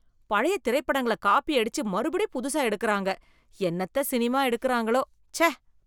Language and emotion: Tamil, disgusted